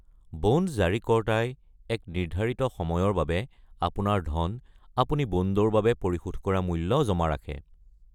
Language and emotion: Assamese, neutral